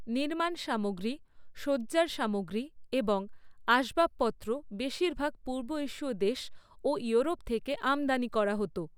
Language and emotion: Bengali, neutral